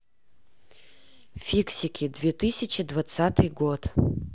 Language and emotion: Russian, neutral